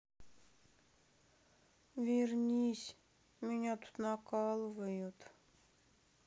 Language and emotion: Russian, sad